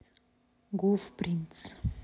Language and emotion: Russian, neutral